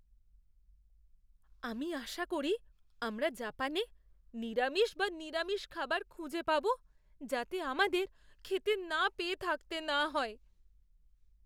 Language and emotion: Bengali, fearful